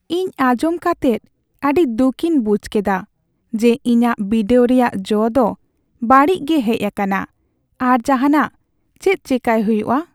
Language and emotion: Santali, sad